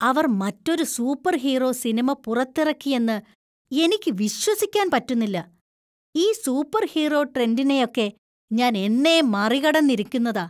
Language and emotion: Malayalam, disgusted